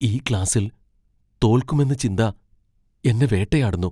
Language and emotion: Malayalam, fearful